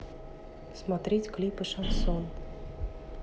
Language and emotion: Russian, neutral